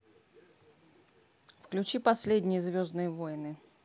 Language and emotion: Russian, neutral